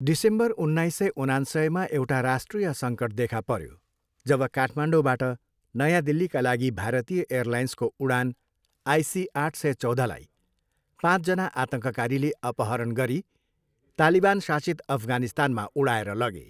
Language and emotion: Nepali, neutral